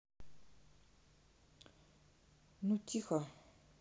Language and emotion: Russian, neutral